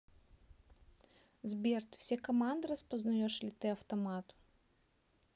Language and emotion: Russian, neutral